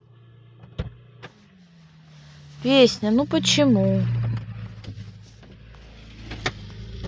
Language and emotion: Russian, neutral